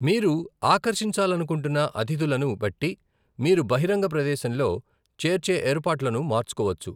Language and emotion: Telugu, neutral